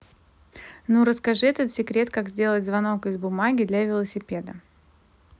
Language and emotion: Russian, neutral